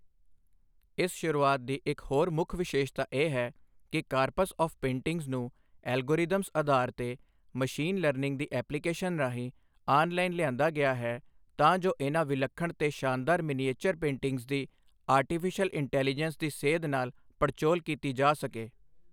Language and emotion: Punjabi, neutral